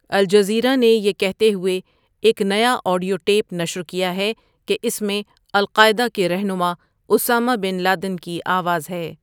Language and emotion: Urdu, neutral